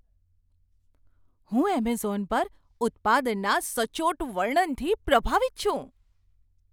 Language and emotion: Gujarati, surprised